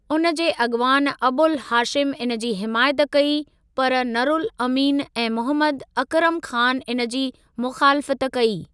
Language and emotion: Sindhi, neutral